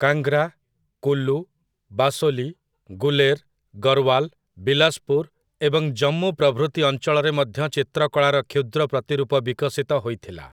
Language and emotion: Odia, neutral